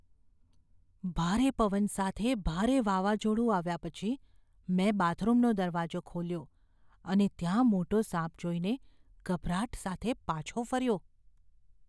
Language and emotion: Gujarati, fearful